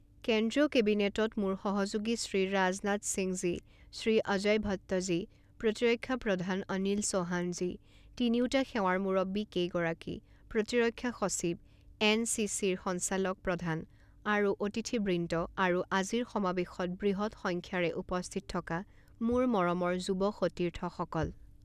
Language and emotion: Assamese, neutral